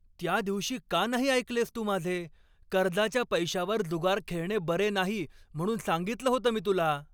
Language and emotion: Marathi, angry